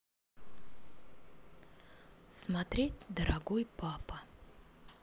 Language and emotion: Russian, neutral